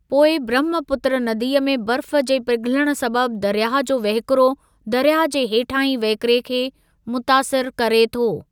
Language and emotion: Sindhi, neutral